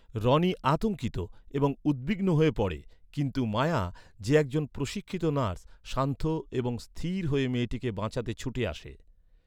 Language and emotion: Bengali, neutral